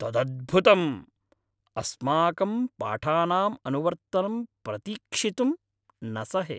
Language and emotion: Sanskrit, happy